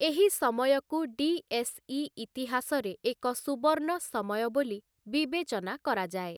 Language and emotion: Odia, neutral